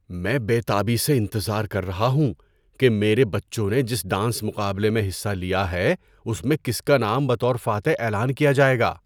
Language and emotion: Urdu, surprised